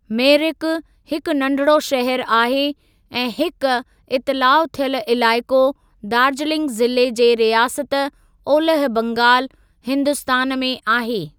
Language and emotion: Sindhi, neutral